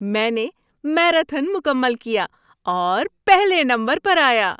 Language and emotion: Urdu, happy